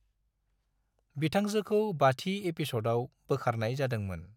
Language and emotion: Bodo, neutral